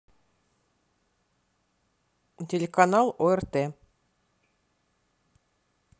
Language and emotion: Russian, neutral